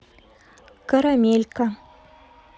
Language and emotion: Russian, neutral